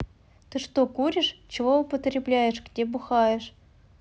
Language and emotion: Russian, neutral